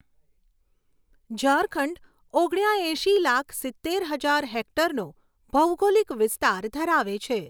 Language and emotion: Gujarati, neutral